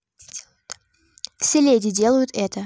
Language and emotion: Russian, neutral